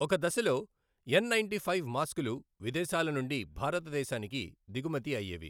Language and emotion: Telugu, neutral